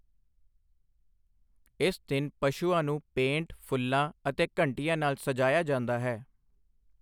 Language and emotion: Punjabi, neutral